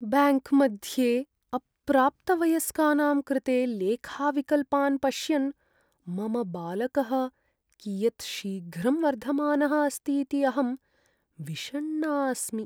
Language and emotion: Sanskrit, sad